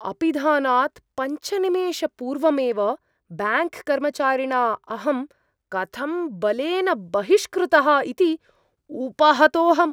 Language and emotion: Sanskrit, surprised